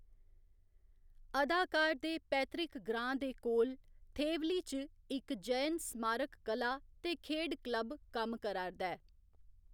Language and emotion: Dogri, neutral